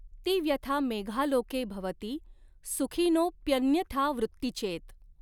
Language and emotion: Marathi, neutral